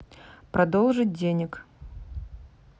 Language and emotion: Russian, neutral